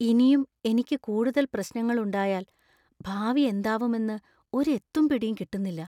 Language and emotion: Malayalam, fearful